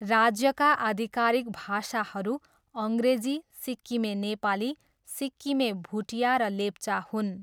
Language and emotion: Nepali, neutral